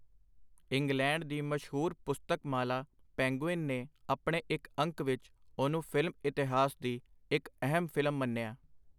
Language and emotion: Punjabi, neutral